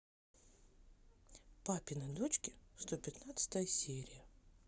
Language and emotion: Russian, positive